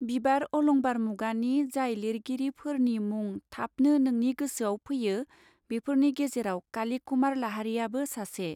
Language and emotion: Bodo, neutral